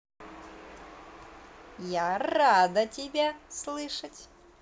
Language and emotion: Russian, positive